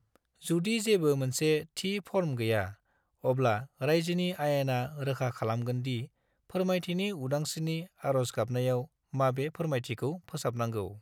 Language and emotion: Bodo, neutral